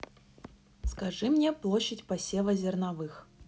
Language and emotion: Russian, neutral